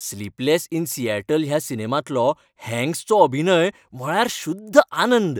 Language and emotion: Goan Konkani, happy